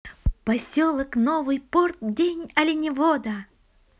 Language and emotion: Russian, positive